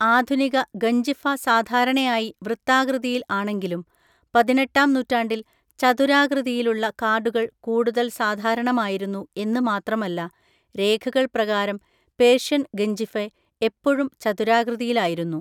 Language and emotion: Malayalam, neutral